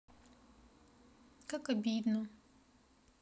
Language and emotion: Russian, sad